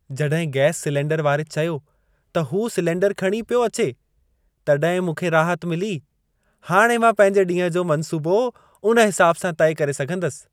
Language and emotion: Sindhi, happy